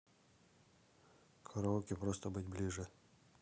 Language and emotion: Russian, neutral